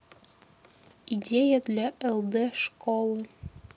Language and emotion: Russian, neutral